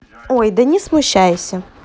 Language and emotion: Russian, neutral